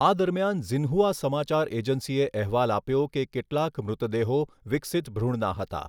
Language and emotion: Gujarati, neutral